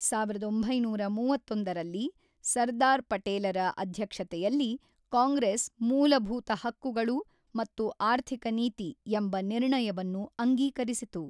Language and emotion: Kannada, neutral